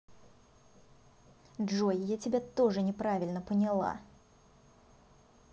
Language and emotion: Russian, angry